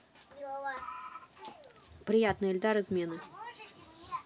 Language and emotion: Russian, neutral